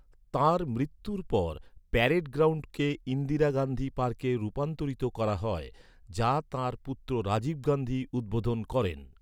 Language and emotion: Bengali, neutral